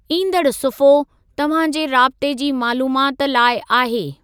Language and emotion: Sindhi, neutral